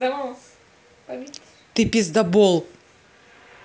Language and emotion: Russian, angry